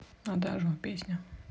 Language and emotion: Russian, neutral